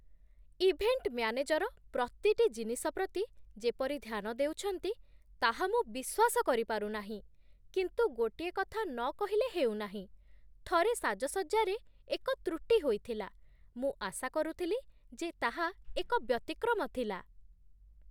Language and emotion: Odia, surprised